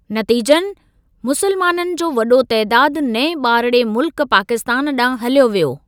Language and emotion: Sindhi, neutral